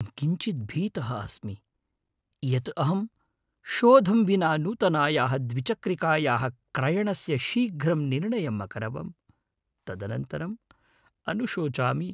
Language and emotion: Sanskrit, fearful